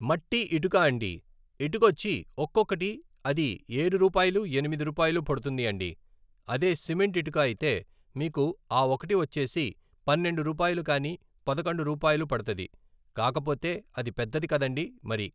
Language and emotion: Telugu, neutral